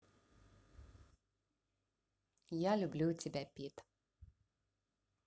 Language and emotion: Russian, positive